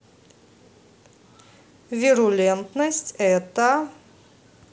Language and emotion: Russian, neutral